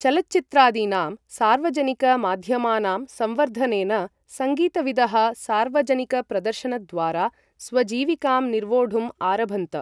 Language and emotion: Sanskrit, neutral